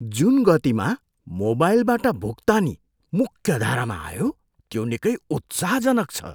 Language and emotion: Nepali, surprised